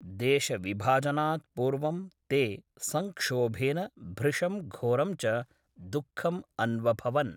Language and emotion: Sanskrit, neutral